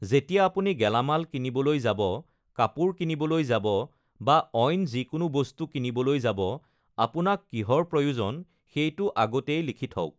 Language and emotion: Assamese, neutral